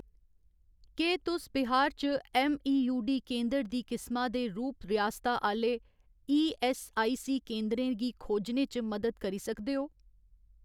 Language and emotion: Dogri, neutral